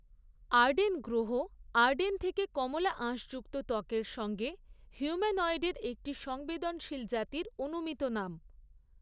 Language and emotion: Bengali, neutral